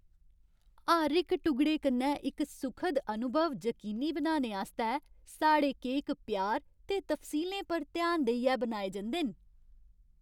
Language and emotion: Dogri, happy